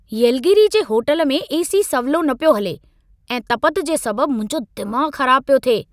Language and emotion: Sindhi, angry